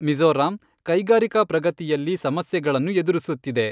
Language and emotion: Kannada, neutral